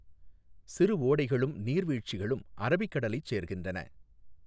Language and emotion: Tamil, neutral